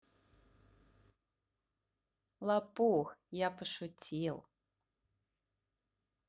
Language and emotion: Russian, positive